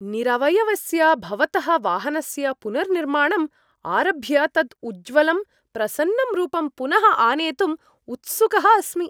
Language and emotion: Sanskrit, happy